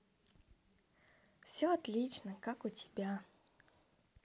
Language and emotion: Russian, positive